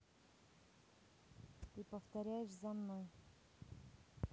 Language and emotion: Russian, neutral